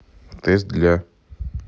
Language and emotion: Russian, neutral